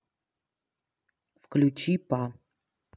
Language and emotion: Russian, neutral